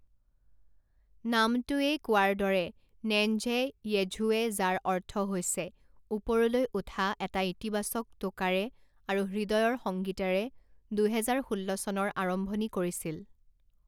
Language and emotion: Assamese, neutral